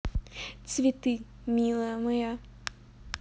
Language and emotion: Russian, positive